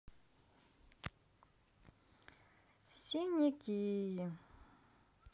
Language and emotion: Russian, neutral